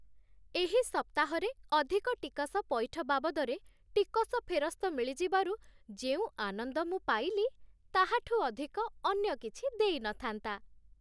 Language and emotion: Odia, happy